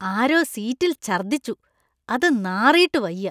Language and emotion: Malayalam, disgusted